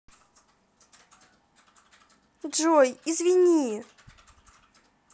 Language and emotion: Russian, sad